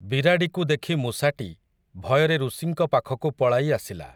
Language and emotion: Odia, neutral